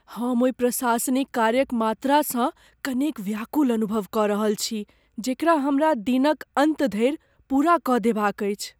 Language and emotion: Maithili, fearful